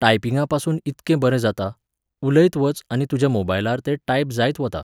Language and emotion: Goan Konkani, neutral